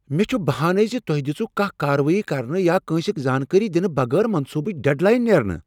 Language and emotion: Kashmiri, angry